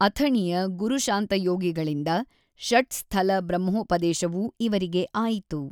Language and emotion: Kannada, neutral